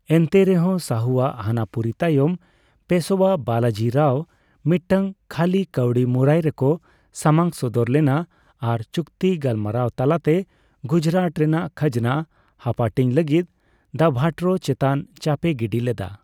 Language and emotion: Santali, neutral